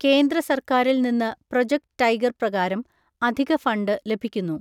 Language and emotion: Malayalam, neutral